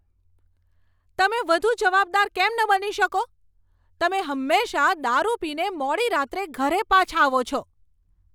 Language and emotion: Gujarati, angry